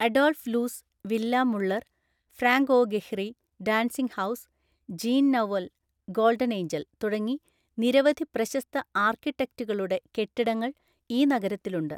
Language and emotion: Malayalam, neutral